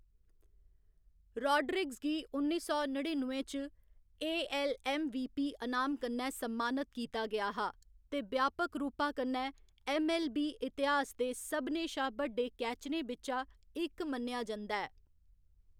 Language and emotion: Dogri, neutral